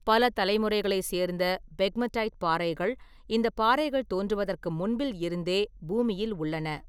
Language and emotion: Tamil, neutral